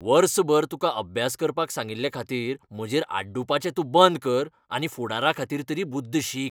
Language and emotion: Goan Konkani, angry